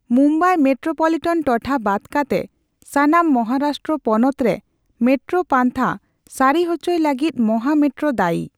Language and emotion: Santali, neutral